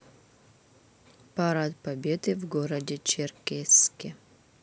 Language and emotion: Russian, neutral